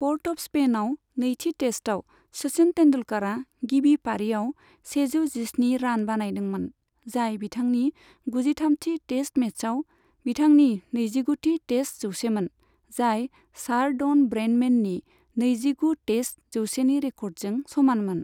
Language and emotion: Bodo, neutral